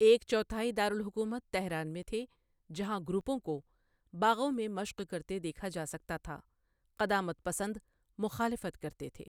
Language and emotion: Urdu, neutral